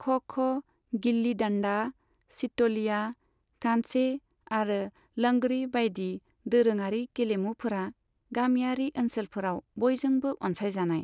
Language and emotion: Bodo, neutral